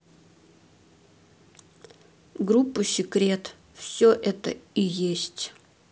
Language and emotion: Russian, neutral